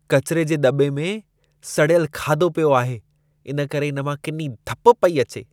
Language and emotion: Sindhi, disgusted